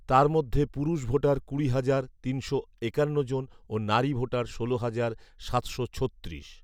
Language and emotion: Bengali, neutral